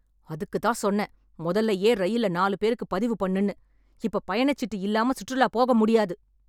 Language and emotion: Tamil, angry